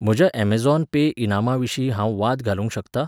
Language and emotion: Goan Konkani, neutral